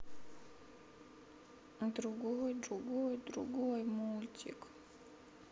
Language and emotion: Russian, sad